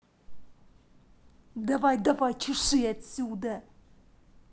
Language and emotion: Russian, angry